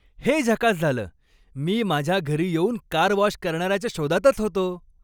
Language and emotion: Marathi, happy